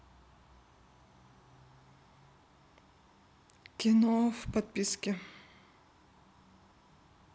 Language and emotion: Russian, neutral